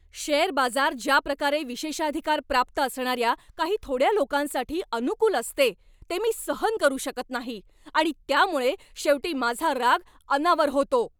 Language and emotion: Marathi, angry